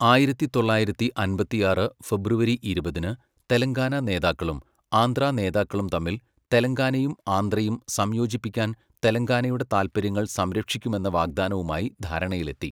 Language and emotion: Malayalam, neutral